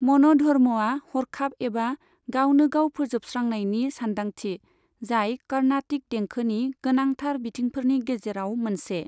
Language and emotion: Bodo, neutral